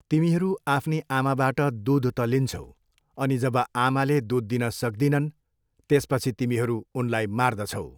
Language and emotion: Nepali, neutral